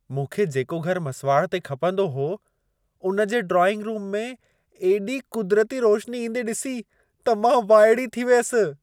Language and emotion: Sindhi, surprised